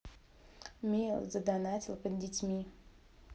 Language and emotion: Russian, neutral